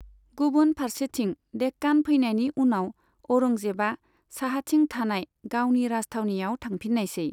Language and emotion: Bodo, neutral